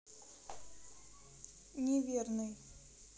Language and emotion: Russian, neutral